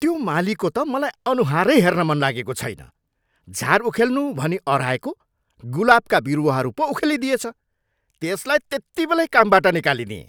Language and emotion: Nepali, angry